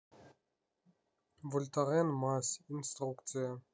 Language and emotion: Russian, neutral